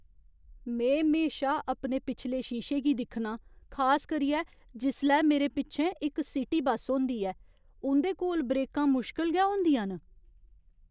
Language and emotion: Dogri, fearful